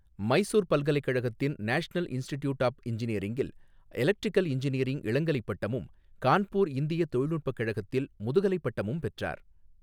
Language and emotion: Tamil, neutral